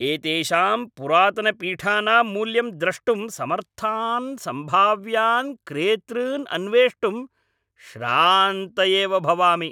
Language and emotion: Sanskrit, angry